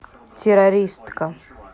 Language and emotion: Russian, neutral